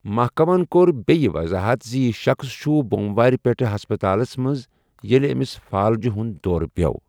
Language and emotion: Kashmiri, neutral